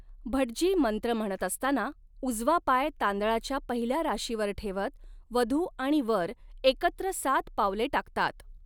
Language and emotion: Marathi, neutral